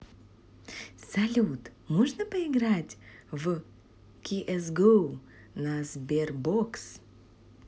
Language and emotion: Russian, positive